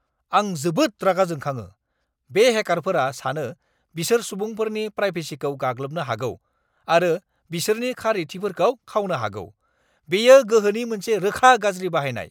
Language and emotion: Bodo, angry